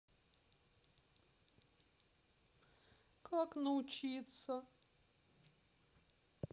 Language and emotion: Russian, sad